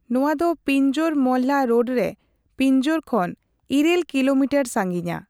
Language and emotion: Santali, neutral